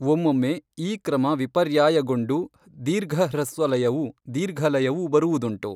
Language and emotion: Kannada, neutral